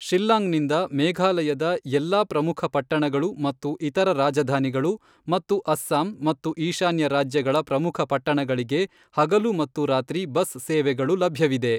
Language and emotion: Kannada, neutral